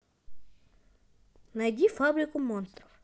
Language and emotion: Russian, positive